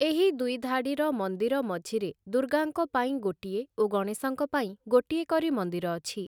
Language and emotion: Odia, neutral